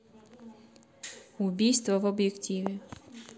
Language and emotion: Russian, neutral